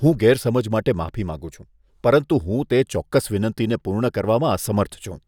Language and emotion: Gujarati, disgusted